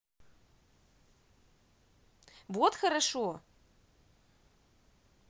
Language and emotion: Russian, positive